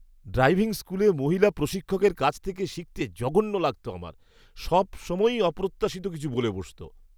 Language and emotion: Bengali, disgusted